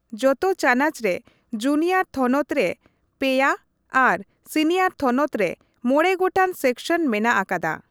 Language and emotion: Santali, neutral